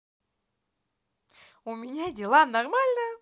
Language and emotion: Russian, positive